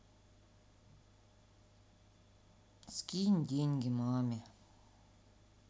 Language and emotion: Russian, sad